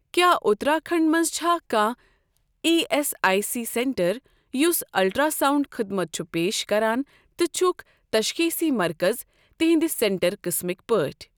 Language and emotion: Kashmiri, neutral